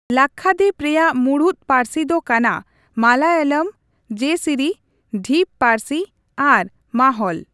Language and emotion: Santali, neutral